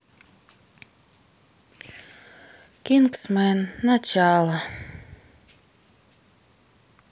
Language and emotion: Russian, sad